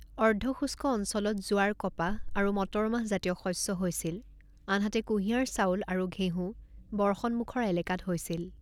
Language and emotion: Assamese, neutral